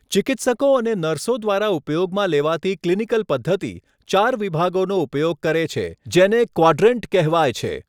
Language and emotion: Gujarati, neutral